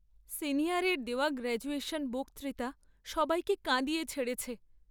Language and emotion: Bengali, sad